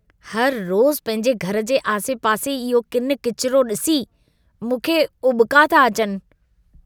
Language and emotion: Sindhi, disgusted